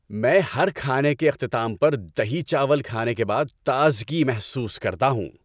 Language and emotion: Urdu, happy